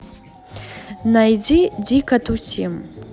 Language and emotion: Russian, neutral